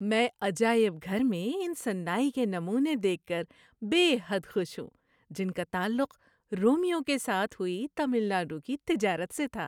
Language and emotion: Urdu, happy